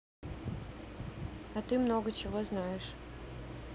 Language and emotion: Russian, neutral